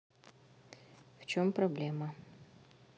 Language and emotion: Russian, neutral